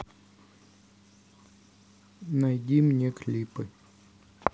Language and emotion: Russian, neutral